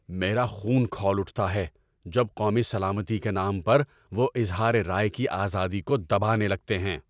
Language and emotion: Urdu, angry